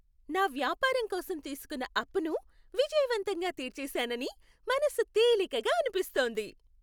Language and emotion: Telugu, happy